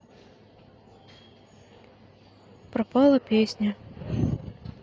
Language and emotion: Russian, neutral